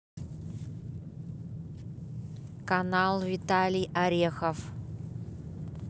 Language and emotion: Russian, neutral